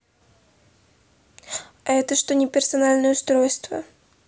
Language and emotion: Russian, neutral